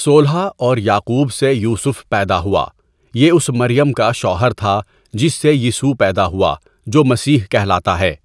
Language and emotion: Urdu, neutral